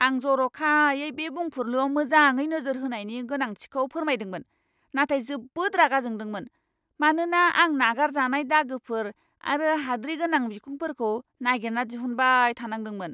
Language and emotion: Bodo, angry